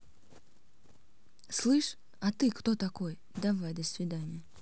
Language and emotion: Russian, neutral